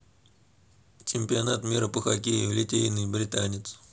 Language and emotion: Russian, neutral